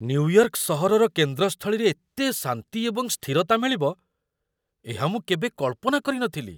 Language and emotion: Odia, surprised